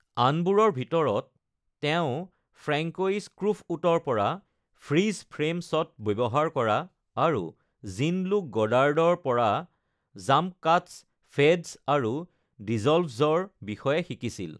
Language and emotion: Assamese, neutral